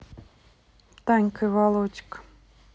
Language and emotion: Russian, neutral